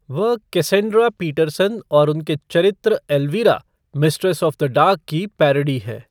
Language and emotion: Hindi, neutral